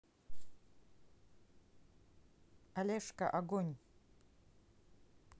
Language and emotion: Russian, neutral